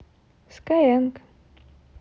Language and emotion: Russian, positive